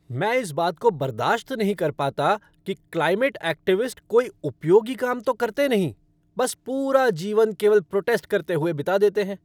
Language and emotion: Hindi, angry